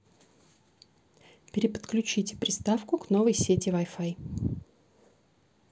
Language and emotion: Russian, neutral